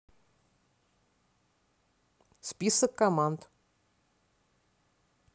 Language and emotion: Russian, neutral